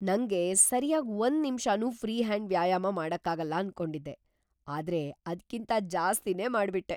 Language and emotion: Kannada, surprised